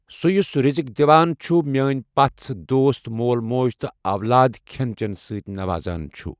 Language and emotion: Kashmiri, neutral